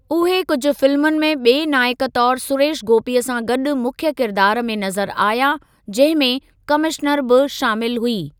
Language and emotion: Sindhi, neutral